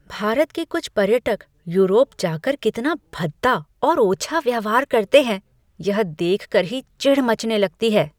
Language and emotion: Hindi, disgusted